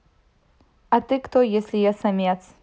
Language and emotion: Russian, neutral